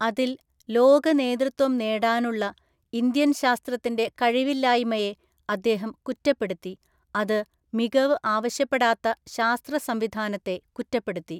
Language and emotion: Malayalam, neutral